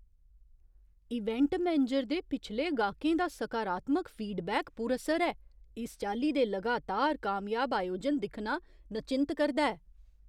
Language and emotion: Dogri, surprised